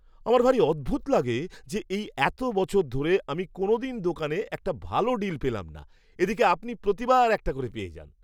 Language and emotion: Bengali, disgusted